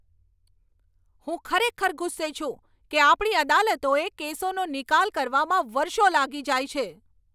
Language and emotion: Gujarati, angry